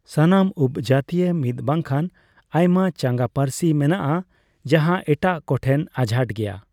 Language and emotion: Santali, neutral